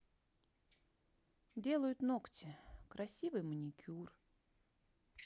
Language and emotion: Russian, positive